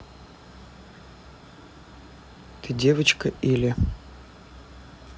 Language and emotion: Russian, neutral